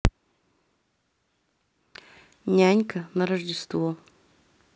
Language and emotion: Russian, neutral